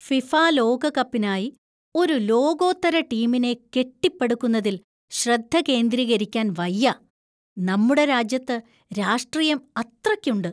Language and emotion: Malayalam, disgusted